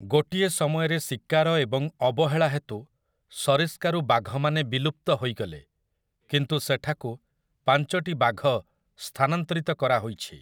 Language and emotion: Odia, neutral